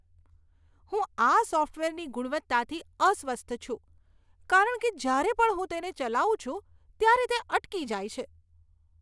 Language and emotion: Gujarati, disgusted